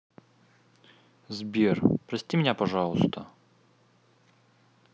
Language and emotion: Russian, sad